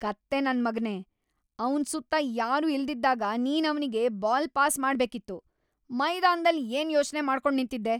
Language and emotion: Kannada, angry